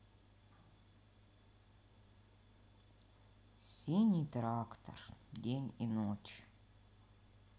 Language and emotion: Russian, sad